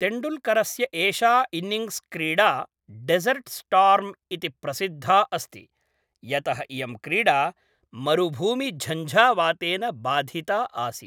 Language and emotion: Sanskrit, neutral